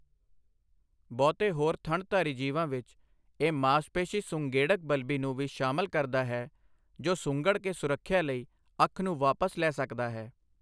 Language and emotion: Punjabi, neutral